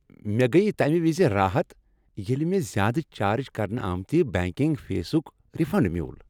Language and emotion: Kashmiri, happy